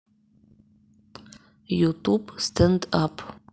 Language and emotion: Russian, neutral